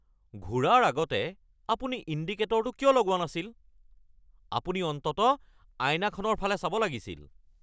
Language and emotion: Assamese, angry